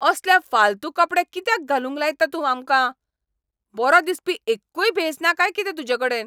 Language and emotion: Goan Konkani, angry